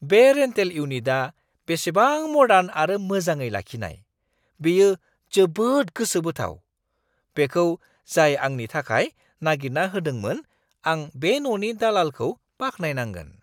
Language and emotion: Bodo, surprised